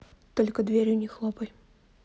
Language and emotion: Russian, neutral